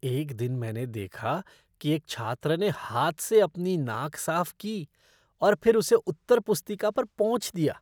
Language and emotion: Hindi, disgusted